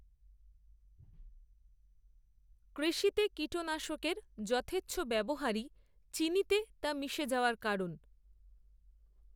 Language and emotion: Bengali, neutral